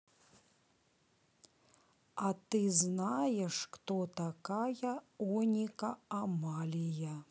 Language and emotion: Russian, neutral